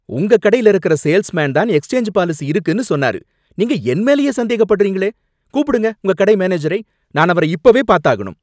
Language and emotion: Tamil, angry